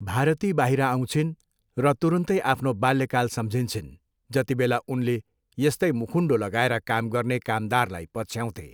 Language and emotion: Nepali, neutral